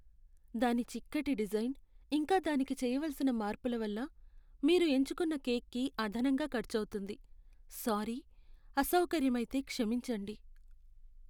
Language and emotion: Telugu, sad